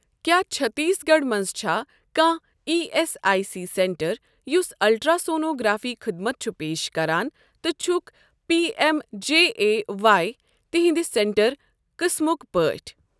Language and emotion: Kashmiri, neutral